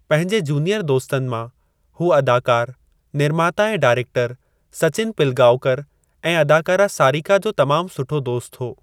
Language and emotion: Sindhi, neutral